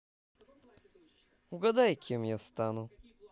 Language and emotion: Russian, positive